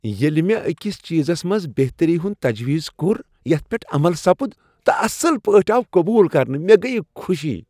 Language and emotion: Kashmiri, happy